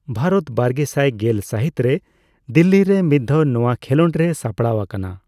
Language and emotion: Santali, neutral